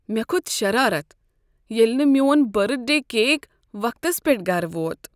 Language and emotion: Kashmiri, sad